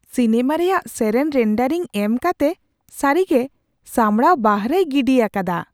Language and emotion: Santali, surprised